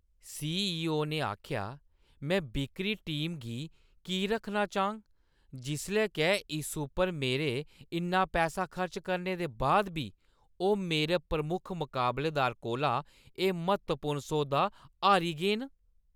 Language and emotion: Dogri, angry